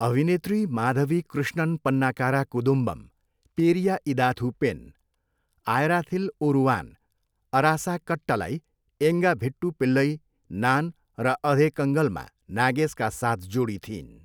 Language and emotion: Nepali, neutral